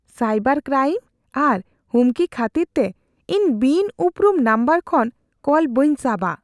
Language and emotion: Santali, fearful